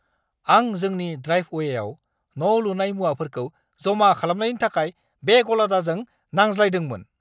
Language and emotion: Bodo, angry